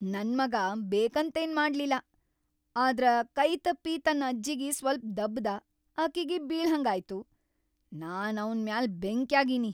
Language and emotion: Kannada, angry